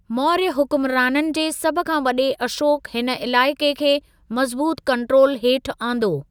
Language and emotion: Sindhi, neutral